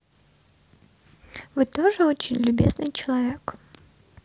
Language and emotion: Russian, positive